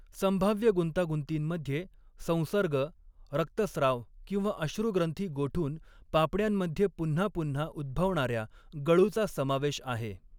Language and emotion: Marathi, neutral